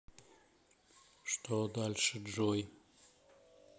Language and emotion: Russian, neutral